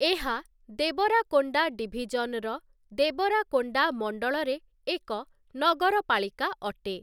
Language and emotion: Odia, neutral